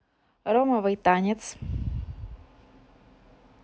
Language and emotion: Russian, neutral